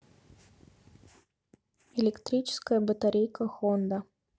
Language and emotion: Russian, neutral